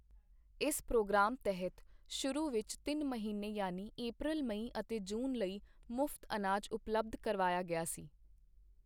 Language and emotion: Punjabi, neutral